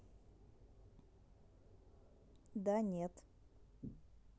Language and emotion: Russian, neutral